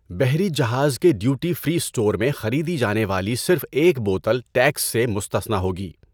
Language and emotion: Urdu, neutral